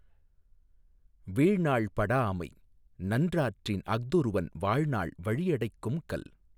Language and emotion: Tamil, neutral